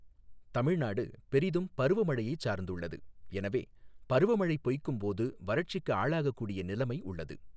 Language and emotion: Tamil, neutral